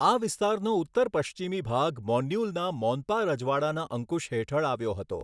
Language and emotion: Gujarati, neutral